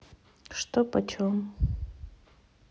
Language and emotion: Russian, neutral